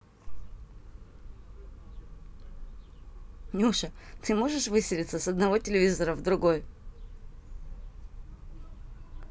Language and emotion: Russian, positive